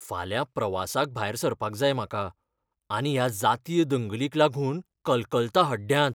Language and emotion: Goan Konkani, fearful